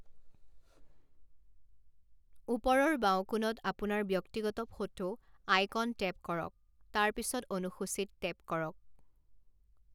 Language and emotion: Assamese, neutral